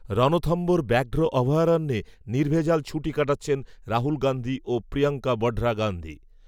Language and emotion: Bengali, neutral